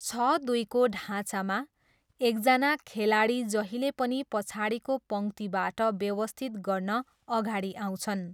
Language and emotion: Nepali, neutral